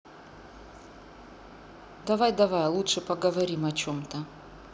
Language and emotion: Russian, neutral